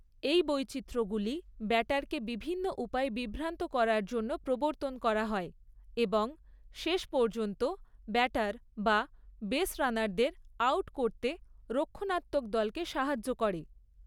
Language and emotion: Bengali, neutral